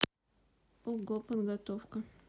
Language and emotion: Russian, neutral